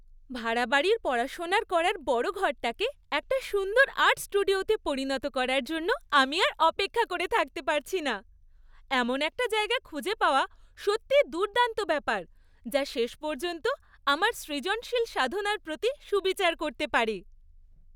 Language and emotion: Bengali, happy